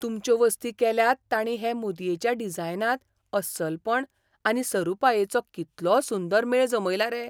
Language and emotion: Goan Konkani, surprised